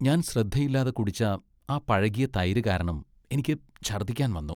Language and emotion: Malayalam, disgusted